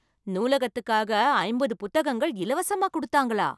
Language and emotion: Tamil, surprised